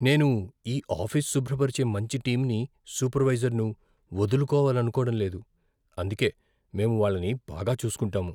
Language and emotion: Telugu, fearful